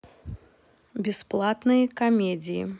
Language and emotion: Russian, neutral